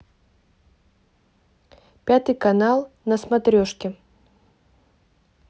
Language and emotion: Russian, neutral